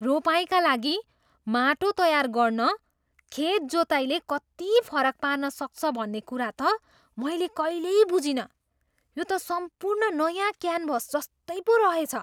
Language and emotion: Nepali, surprised